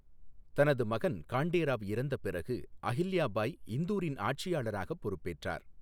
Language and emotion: Tamil, neutral